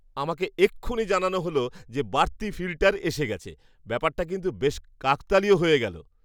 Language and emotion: Bengali, surprised